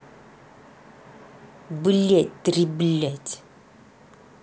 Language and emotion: Russian, angry